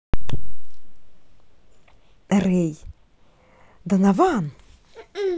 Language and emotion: Russian, positive